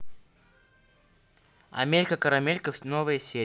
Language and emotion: Russian, neutral